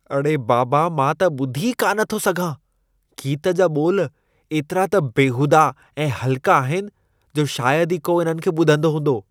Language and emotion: Sindhi, disgusted